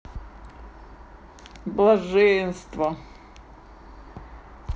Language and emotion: Russian, positive